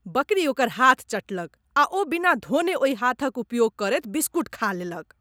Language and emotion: Maithili, disgusted